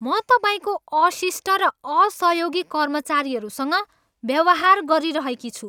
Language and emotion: Nepali, angry